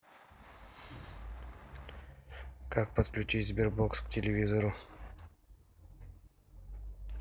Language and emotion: Russian, neutral